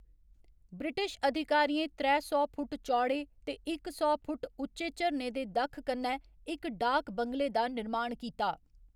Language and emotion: Dogri, neutral